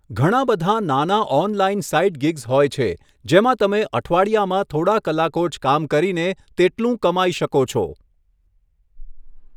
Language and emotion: Gujarati, neutral